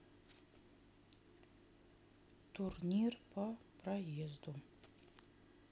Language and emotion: Russian, neutral